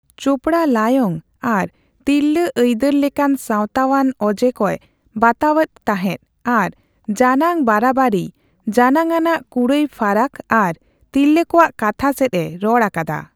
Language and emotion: Santali, neutral